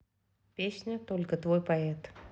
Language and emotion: Russian, neutral